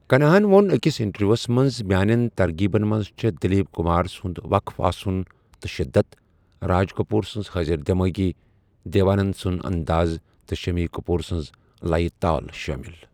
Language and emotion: Kashmiri, neutral